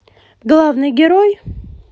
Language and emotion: Russian, neutral